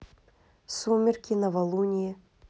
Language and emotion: Russian, neutral